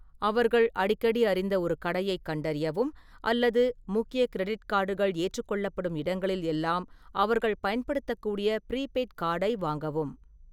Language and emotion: Tamil, neutral